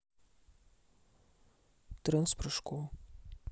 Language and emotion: Russian, neutral